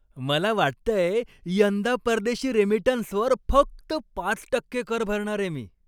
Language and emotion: Marathi, happy